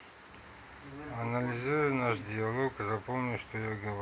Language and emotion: Russian, neutral